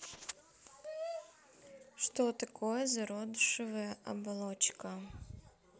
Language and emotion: Russian, neutral